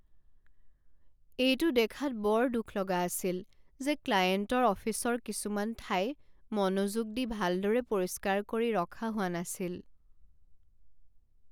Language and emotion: Assamese, sad